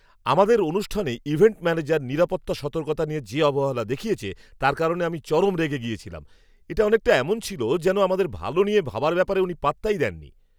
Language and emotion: Bengali, angry